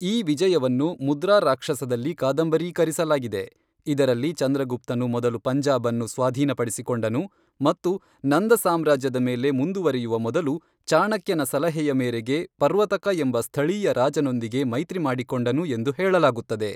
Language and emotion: Kannada, neutral